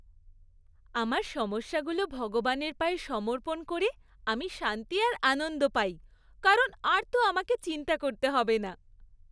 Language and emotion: Bengali, happy